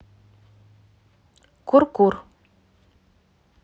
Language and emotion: Russian, neutral